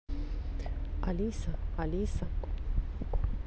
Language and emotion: Russian, neutral